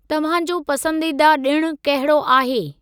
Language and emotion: Sindhi, neutral